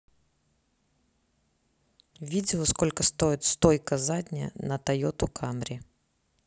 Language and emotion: Russian, neutral